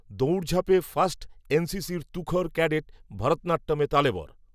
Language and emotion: Bengali, neutral